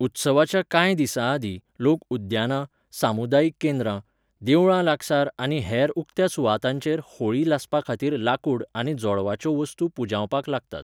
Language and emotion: Goan Konkani, neutral